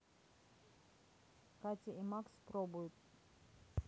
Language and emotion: Russian, neutral